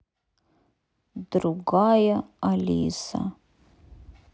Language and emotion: Russian, sad